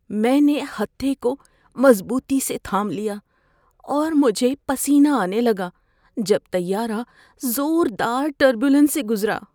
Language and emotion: Urdu, fearful